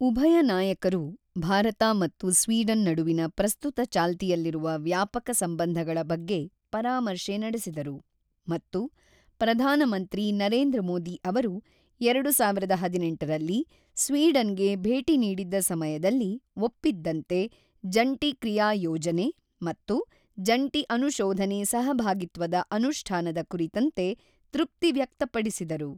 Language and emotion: Kannada, neutral